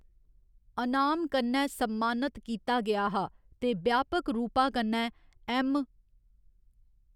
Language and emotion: Dogri, neutral